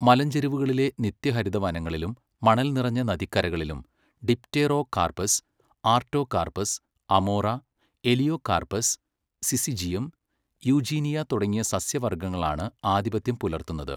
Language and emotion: Malayalam, neutral